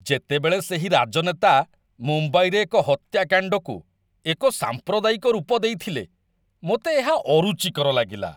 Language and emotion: Odia, disgusted